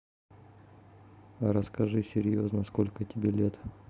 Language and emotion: Russian, neutral